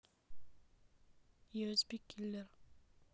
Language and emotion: Russian, neutral